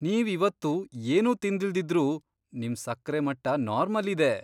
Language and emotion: Kannada, surprised